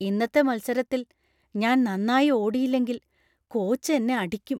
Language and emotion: Malayalam, fearful